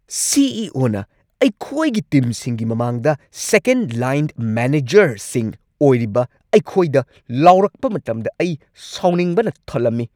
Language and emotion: Manipuri, angry